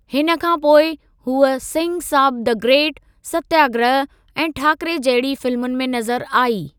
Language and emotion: Sindhi, neutral